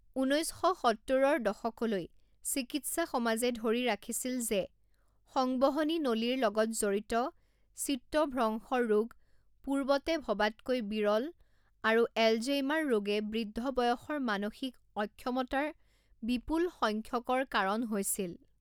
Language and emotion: Assamese, neutral